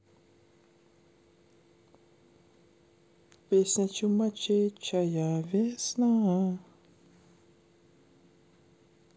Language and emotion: Russian, neutral